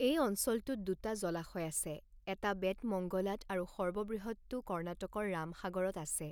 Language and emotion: Assamese, neutral